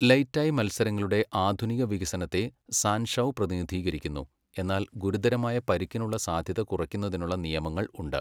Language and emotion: Malayalam, neutral